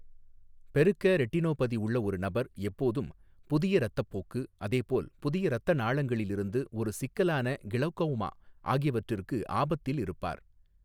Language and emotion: Tamil, neutral